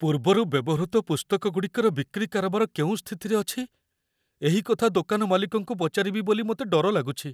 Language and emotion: Odia, fearful